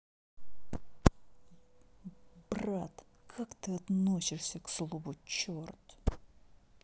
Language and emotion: Russian, neutral